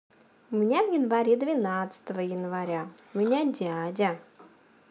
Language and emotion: Russian, positive